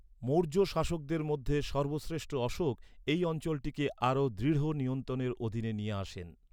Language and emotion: Bengali, neutral